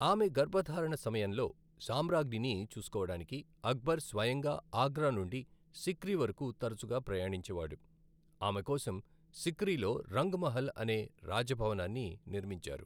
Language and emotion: Telugu, neutral